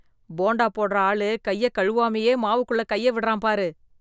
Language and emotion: Tamil, disgusted